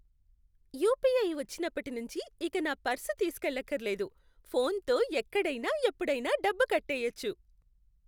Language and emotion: Telugu, happy